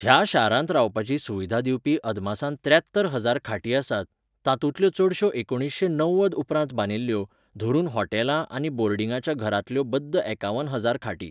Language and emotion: Goan Konkani, neutral